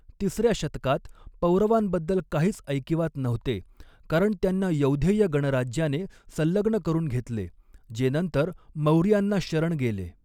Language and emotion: Marathi, neutral